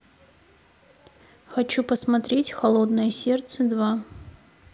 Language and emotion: Russian, neutral